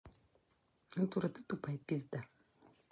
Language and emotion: Russian, angry